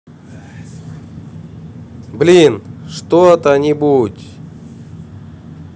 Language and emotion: Russian, angry